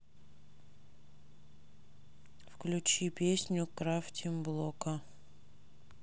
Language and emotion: Russian, neutral